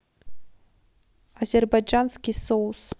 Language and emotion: Russian, neutral